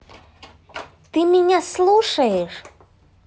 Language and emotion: Russian, neutral